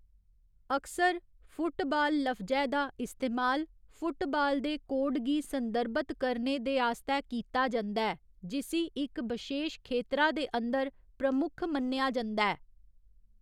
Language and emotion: Dogri, neutral